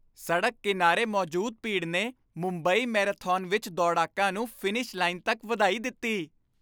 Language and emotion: Punjabi, happy